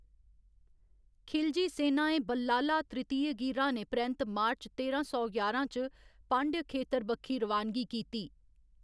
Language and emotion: Dogri, neutral